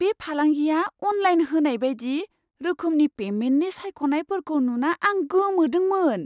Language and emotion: Bodo, surprised